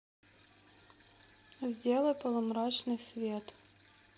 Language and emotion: Russian, neutral